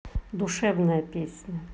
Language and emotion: Russian, positive